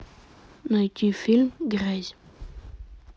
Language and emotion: Russian, neutral